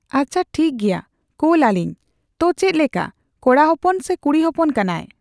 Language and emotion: Santali, neutral